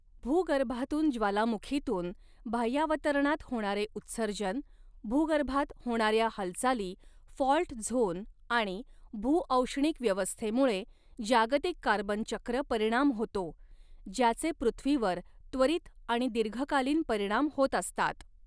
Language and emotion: Marathi, neutral